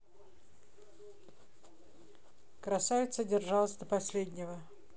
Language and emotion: Russian, neutral